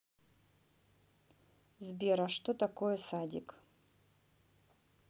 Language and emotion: Russian, neutral